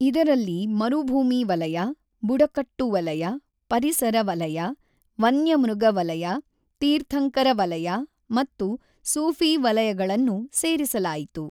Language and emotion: Kannada, neutral